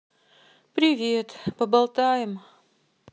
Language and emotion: Russian, sad